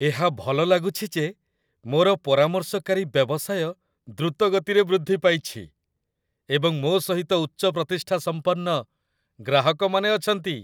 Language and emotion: Odia, happy